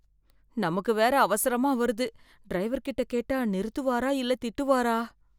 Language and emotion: Tamil, fearful